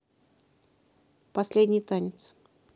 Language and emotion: Russian, neutral